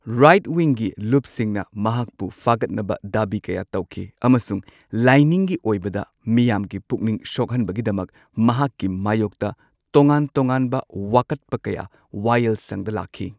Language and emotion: Manipuri, neutral